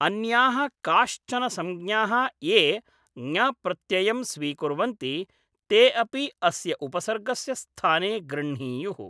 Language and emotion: Sanskrit, neutral